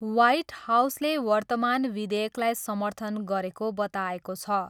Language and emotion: Nepali, neutral